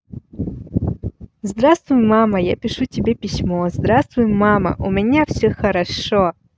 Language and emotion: Russian, positive